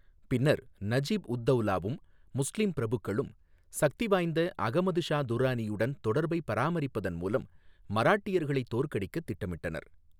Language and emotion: Tamil, neutral